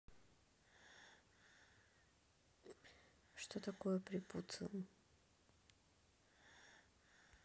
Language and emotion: Russian, neutral